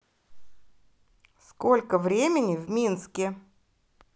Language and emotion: Russian, positive